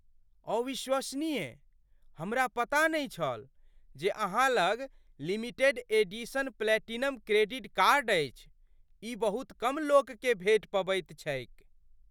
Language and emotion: Maithili, surprised